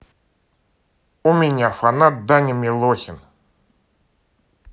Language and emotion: Russian, positive